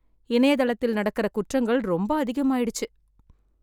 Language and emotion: Tamil, sad